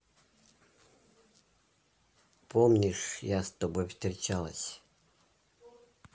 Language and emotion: Russian, neutral